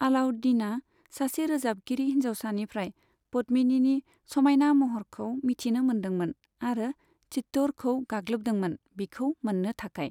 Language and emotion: Bodo, neutral